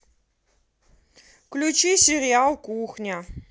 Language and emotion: Russian, neutral